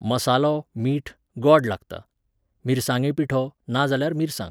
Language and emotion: Goan Konkani, neutral